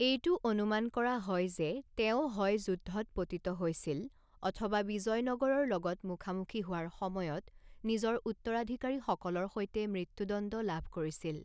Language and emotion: Assamese, neutral